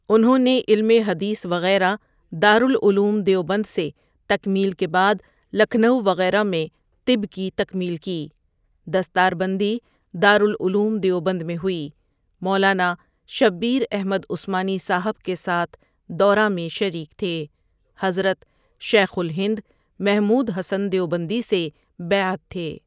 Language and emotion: Urdu, neutral